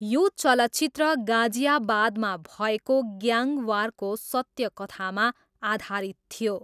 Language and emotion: Nepali, neutral